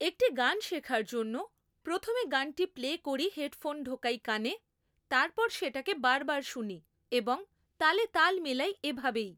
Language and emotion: Bengali, neutral